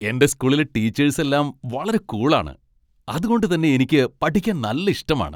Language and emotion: Malayalam, happy